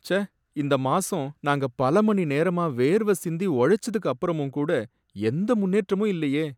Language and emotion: Tamil, sad